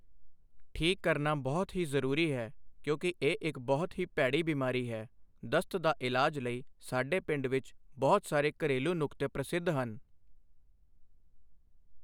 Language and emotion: Punjabi, neutral